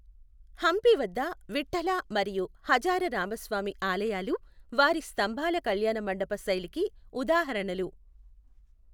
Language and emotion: Telugu, neutral